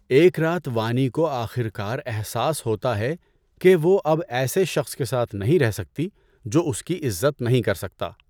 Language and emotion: Urdu, neutral